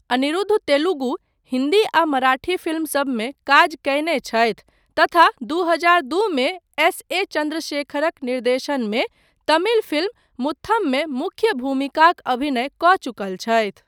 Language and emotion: Maithili, neutral